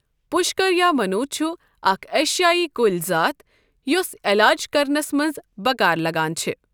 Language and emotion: Kashmiri, neutral